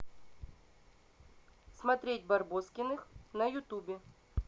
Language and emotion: Russian, neutral